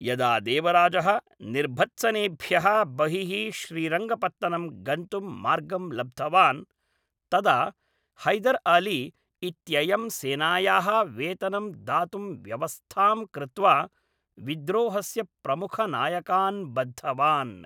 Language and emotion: Sanskrit, neutral